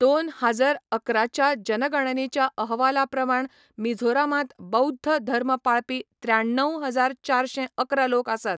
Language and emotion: Goan Konkani, neutral